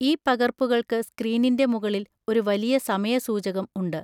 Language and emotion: Malayalam, neutral